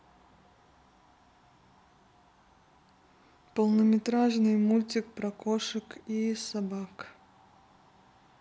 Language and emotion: Russian, neutral